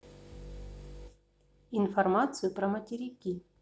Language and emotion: Russian, neutral